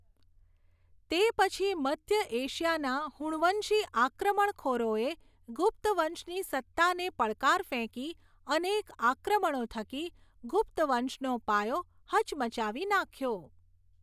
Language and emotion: Gujarati, neutral